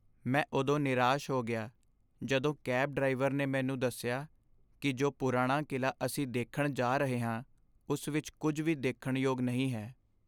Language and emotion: Punjabi, sad